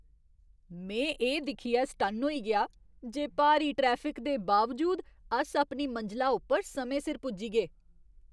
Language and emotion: Dogri, surprised